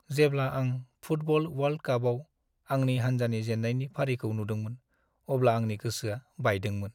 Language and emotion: Bodo, sad